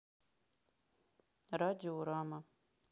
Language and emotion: Russian, neutral